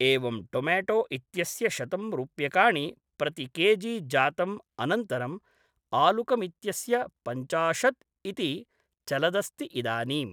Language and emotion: Sanskrit, neutral